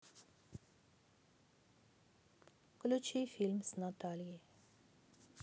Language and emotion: Russian, sad